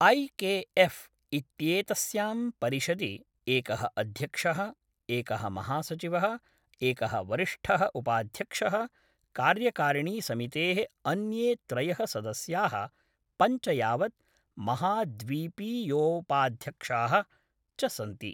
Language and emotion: Sanskrit, neutral